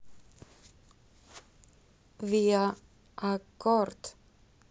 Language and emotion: Russian, positive